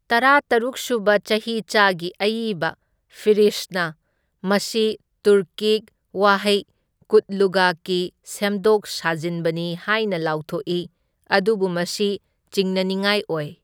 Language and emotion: Manipuri, neutral